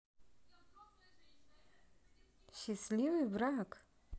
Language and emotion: Russian, positive